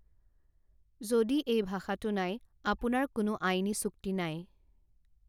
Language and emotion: Assamese, neutral